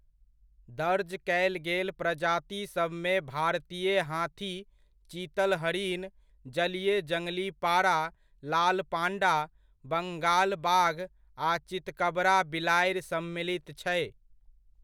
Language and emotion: Maithili, neutral